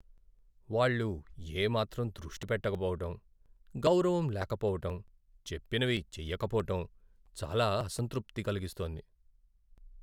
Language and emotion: Telugu, sad